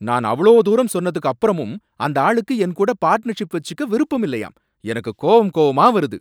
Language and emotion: Tamil, angry